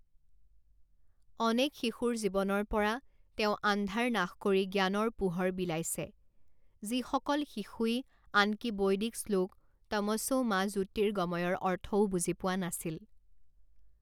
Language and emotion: Assamese, neutral